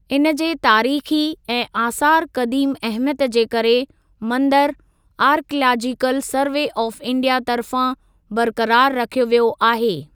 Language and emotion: Sindhi, neutral